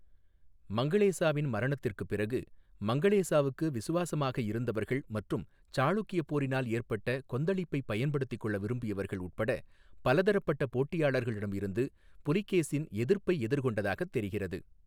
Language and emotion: Tamil, neutral